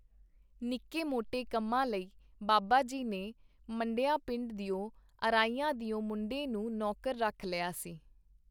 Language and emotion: Punjabi, neutral